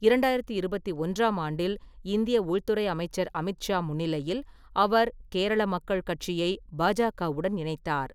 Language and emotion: Tamil, neutral